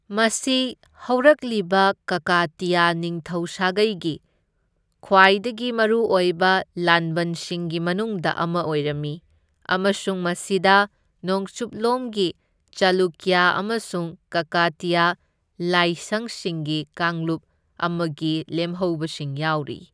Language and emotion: Manipuri, neutral